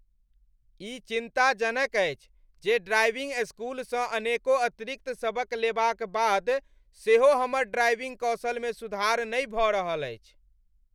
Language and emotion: Maithili, angry